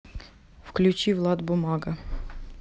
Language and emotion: Russian, neutral